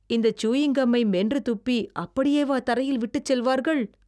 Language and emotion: Tamil, disgusted